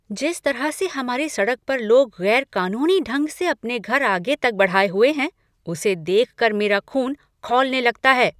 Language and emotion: Hindi, angry